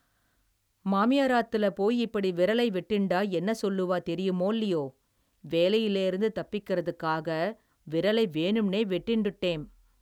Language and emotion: Tamil, neutral